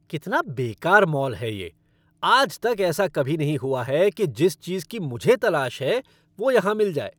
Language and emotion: Hindi, angry